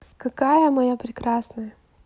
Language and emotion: Russian, positive